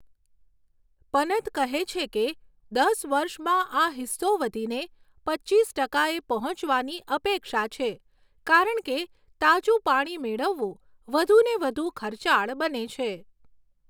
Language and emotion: Gujarati, neutral